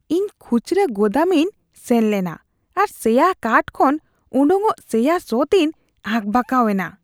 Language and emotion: Santali, disgusted